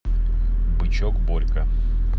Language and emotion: Russian, neutral